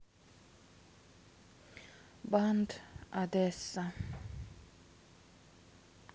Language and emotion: Russian, neutral